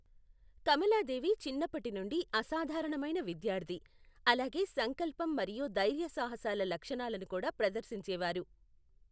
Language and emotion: Telugu, neutral